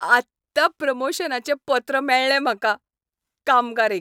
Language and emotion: Goan Konkani, happy